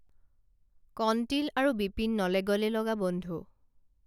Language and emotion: Assamese, neutral